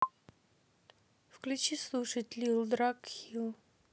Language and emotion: Russian, neutral